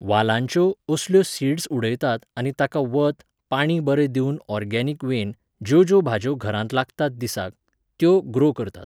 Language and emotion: Goan Konkani, neutral